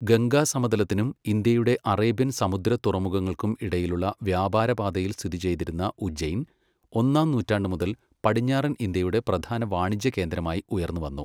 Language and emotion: Malayalam, neutral